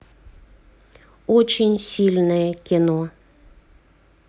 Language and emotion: Russian, neutral